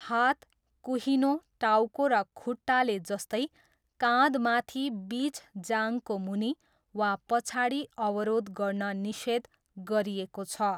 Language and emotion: Nepali, neutral